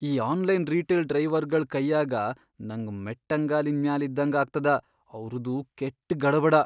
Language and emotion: Kannada, fearful